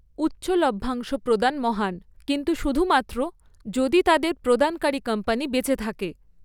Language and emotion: Bengali, neutral